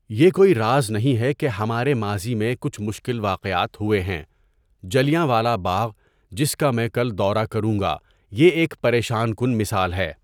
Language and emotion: Urdu, neutral